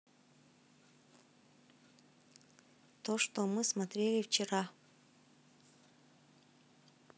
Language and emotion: Russian, neutral